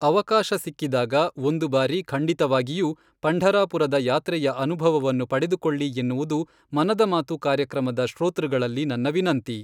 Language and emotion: Kannada, neutral